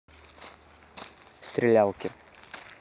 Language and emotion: Russian, neutral